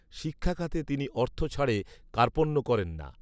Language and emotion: Bengali, neutral